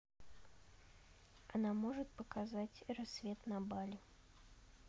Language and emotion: Russian, neutral